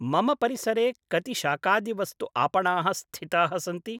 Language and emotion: Sanskrit, neutral